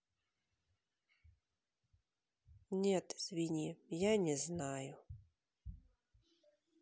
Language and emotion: Russian, sad